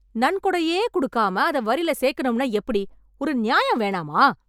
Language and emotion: Tamil, angry